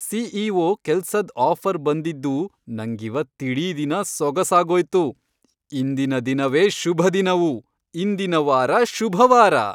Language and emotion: Kannada, happy